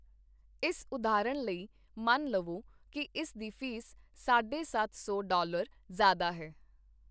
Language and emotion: Punjabi, neutral